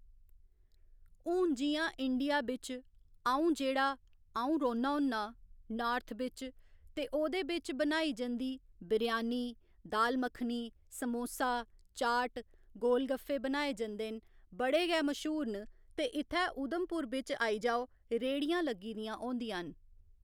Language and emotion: Dogri, neutral